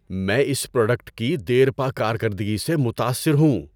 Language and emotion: Urdu, surprised